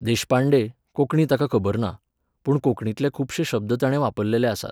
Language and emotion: Goan Konkani, neutral